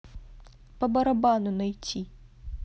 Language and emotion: Russian, neutral